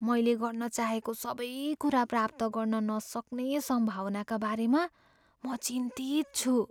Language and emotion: Nepali, fearful